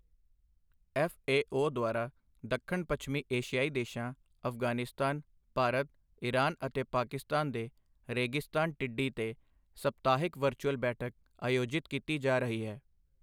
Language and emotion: Punjabi, neutral